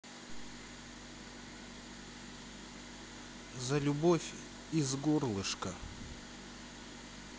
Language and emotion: Russian, sad